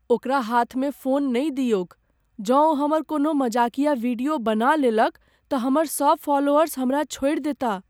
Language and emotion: Maithili, fearful